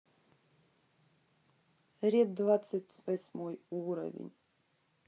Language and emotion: Russian, neutral